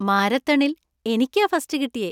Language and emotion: Malayalam, happy